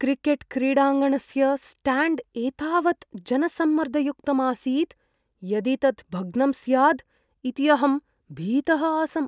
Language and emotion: Sanskrit, fearful